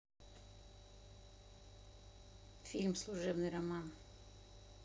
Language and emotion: Russian, neutral